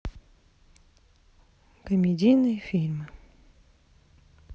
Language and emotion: Russian, sad